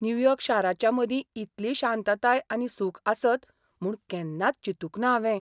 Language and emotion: Goan Konkani, surprised